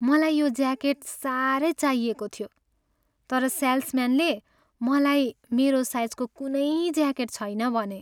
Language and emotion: Nepali, sad